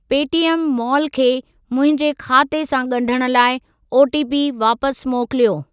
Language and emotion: Sindhi, neutral